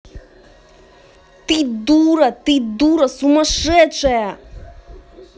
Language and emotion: Russian, angry